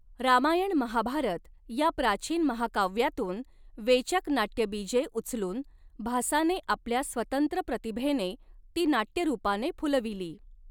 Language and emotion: Marathi, neutral